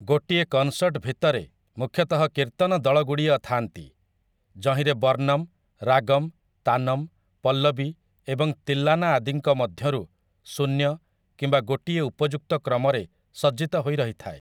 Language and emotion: Odia, neutral